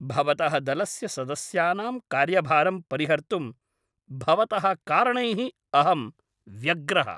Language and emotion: Sanskrit, angry